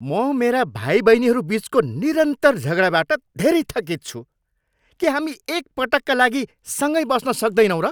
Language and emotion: Nepali, angry